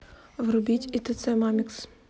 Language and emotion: Russian, neutral